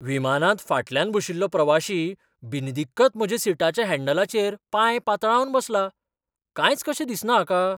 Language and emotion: Goan Konkani, surprised